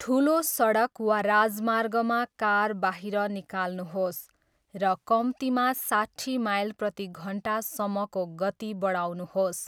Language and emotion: Nepali, neutral